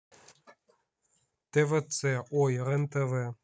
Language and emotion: Russian, neutral